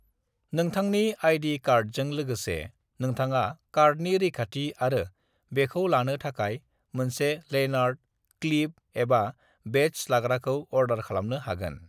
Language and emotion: Bodo, neutral